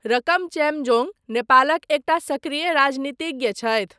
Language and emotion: Maithili, neutral